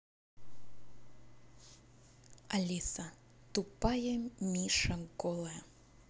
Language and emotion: Russian, neutral